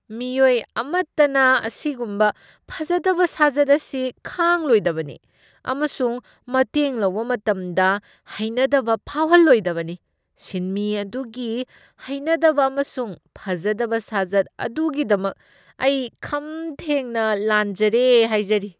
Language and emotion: Manipuri, disgusted